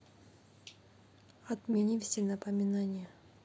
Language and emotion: Russian, neutral